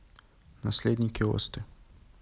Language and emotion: Russian, neutral